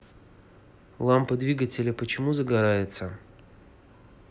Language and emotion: Russian, neutral